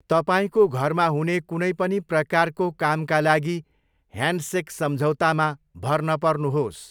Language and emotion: Nepali, neutral